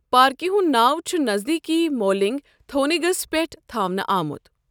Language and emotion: Kashmiri, neutral